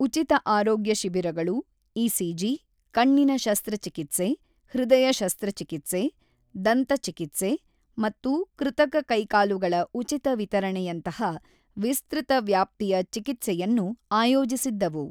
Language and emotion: Kannada, neutral